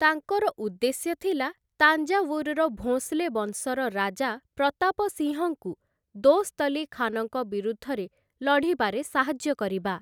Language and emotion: Odia, neutral